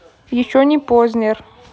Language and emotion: Russian, neutral